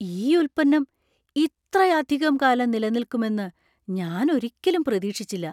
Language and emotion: Malayalam, surprised